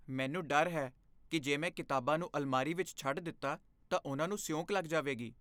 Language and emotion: Punjabi, fearful